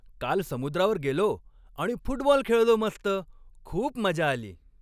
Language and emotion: Marathi, happy